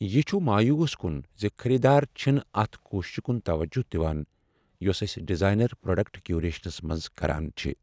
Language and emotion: Kashmiri, sad